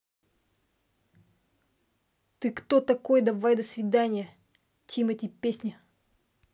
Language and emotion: Russian, angry